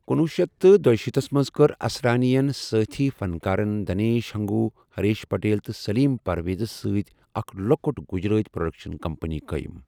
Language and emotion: Kashmiri, neutral